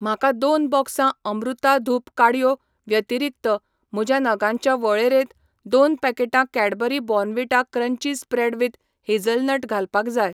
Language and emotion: Goan Konkani, neutral